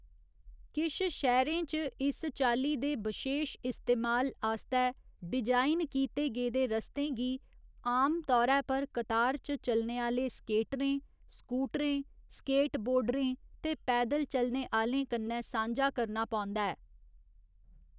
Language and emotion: Dogri, neutral